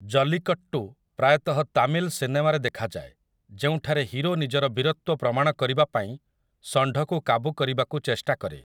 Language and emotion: Odia, neutral